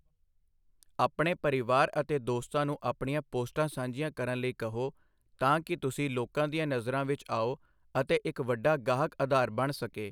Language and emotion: Punjabi, neutral